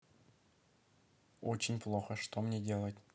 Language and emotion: Russian, neutral